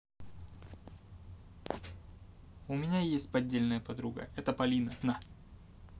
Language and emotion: Russian, neutral